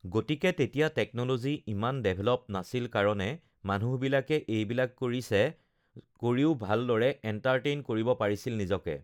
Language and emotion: Assamese, neutral